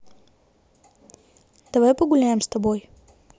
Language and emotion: Russian, neutral